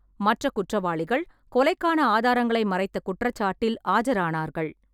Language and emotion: Tamil, neutral